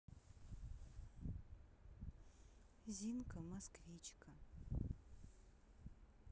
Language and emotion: Russian, neutral